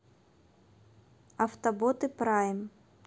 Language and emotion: Russian, neutral